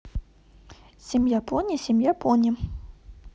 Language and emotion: Russian, positive